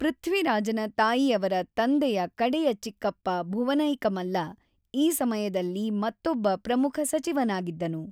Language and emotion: Kannada, neutral